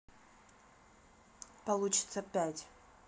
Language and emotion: Russian, neutral